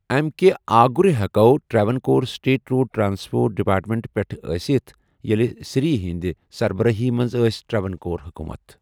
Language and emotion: Kashmiri, neutral